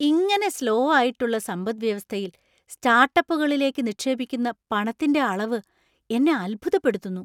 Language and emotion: Malayalam, surprised